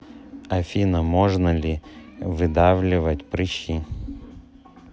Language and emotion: Russian, neutral